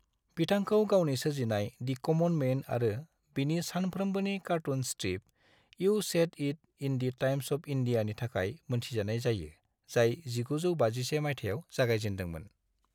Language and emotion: Bodo, neutral